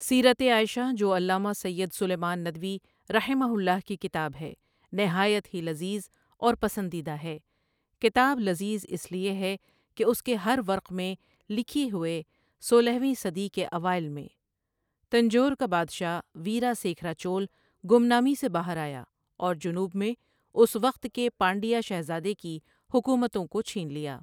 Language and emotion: Urdu, neutral